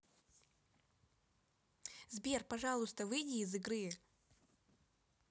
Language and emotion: Russian, neutral